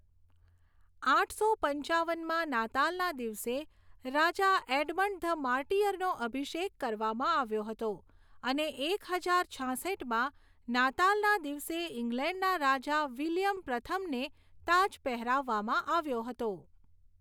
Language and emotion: Gujarati, neutral